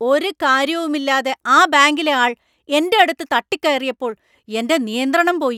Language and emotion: Malayalam, angry